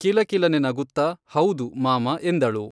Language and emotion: Kannada, neutral